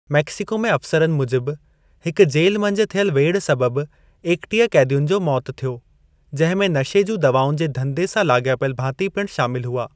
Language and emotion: Sindhi, neutral